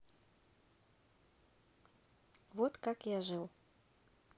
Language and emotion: Russian, neutral